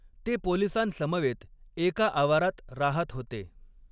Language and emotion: Marathi, neutral